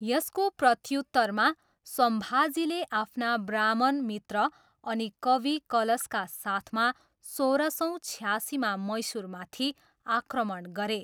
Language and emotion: Nepali, neutral